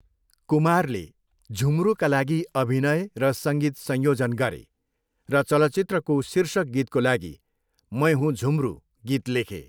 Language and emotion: Nepali, neutral